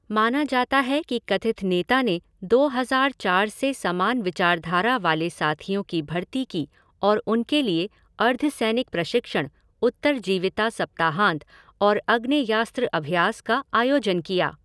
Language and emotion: Hindi, neutral